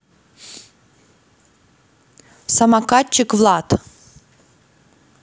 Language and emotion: Russian, neutral